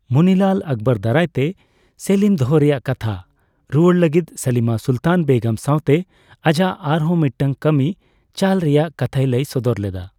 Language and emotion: Santali, neutral